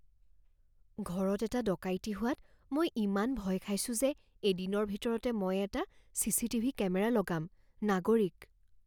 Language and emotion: Assamese, fearful